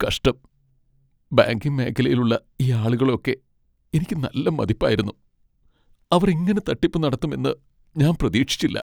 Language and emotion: Malayalam, sad